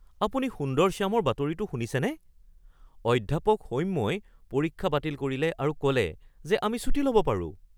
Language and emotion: Assamese, surprised